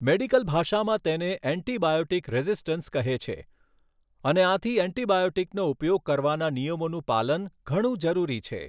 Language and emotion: Gujarati, neutral